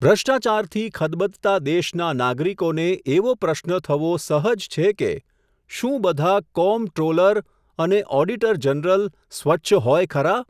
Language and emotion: Gujarati, neutral